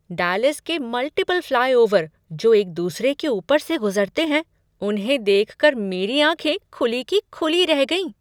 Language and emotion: Hindi, surprised